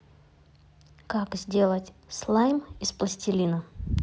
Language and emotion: Russian, neutral